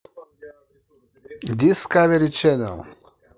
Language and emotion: Russian, positive